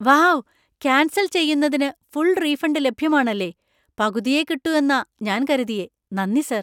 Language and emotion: Malayalam, surprised